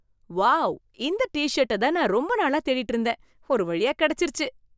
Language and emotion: Tamil, surprised